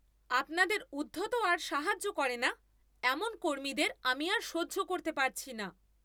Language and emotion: Bengali, angry